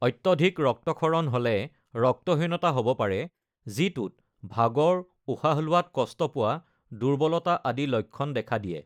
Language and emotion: Assamese, neutral